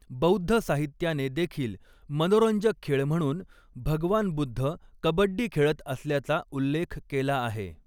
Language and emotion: Marathi, neutral